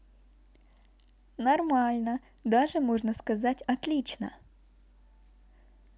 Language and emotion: Russian, positive